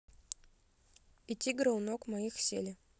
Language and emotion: Russian, neutral